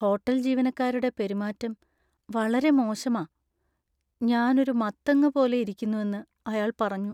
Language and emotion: Malayalam, sad